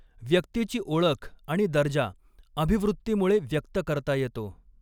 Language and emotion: Marathi, neutral